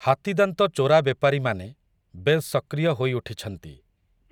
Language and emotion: Odia, neutral